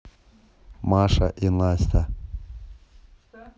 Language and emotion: Russian, neutral